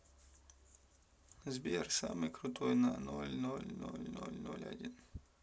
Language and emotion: Russian, sad